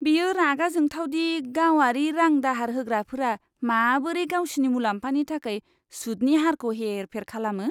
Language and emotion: Bodo, disgusted